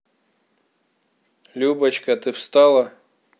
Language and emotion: Russian, neutral